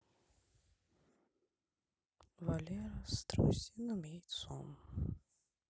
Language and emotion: Russian, sad